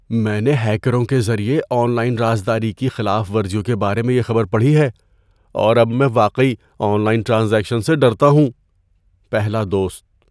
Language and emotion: Urdu, fearful